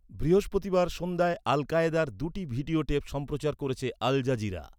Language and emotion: Bengali, neutral